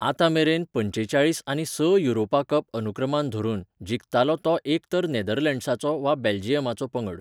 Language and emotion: Goan Konkani, neutral